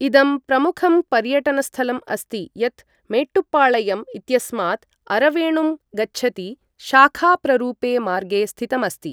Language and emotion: Sanskrit, neutral